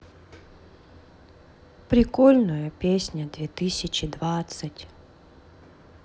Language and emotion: Russian, sad